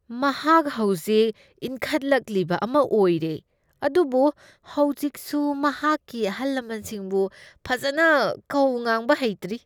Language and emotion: Manipuri, disgusted